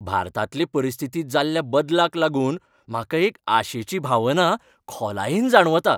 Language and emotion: Goan Konkani, happy